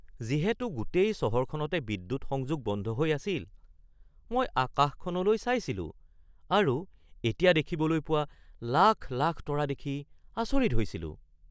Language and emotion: Assamese, surprised